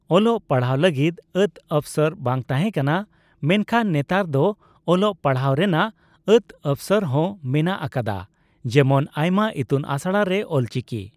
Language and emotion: Santali, neutral